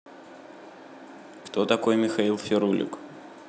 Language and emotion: Russian, neutral